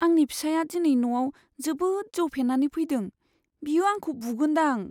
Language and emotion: Bodo, fearful